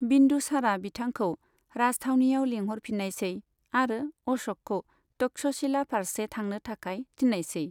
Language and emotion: Bodo, neutral